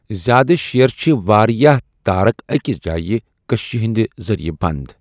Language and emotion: Kashmiri, neutral